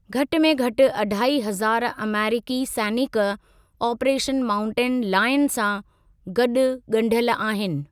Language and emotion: Sindhi, neutral